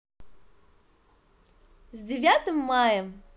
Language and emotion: Russian, positive